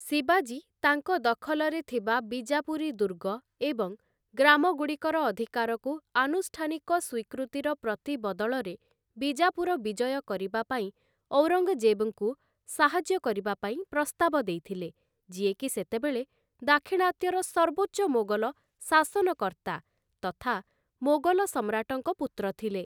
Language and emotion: Odia, neutral